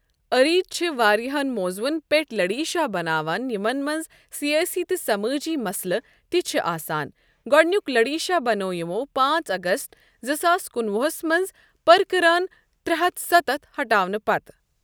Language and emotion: Kashmiri, neutral